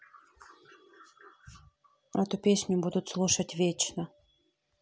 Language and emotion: Russian, neutral